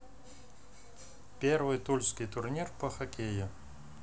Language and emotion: Russian, neutral